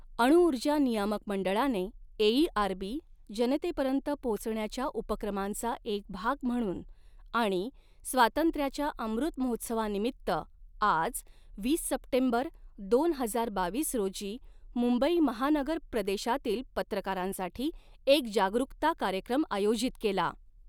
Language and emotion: Marathi, neutral